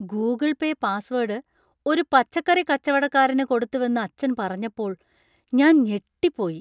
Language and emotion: Malayalam, surprised